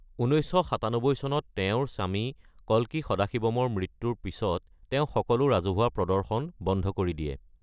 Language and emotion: Assamese, neutral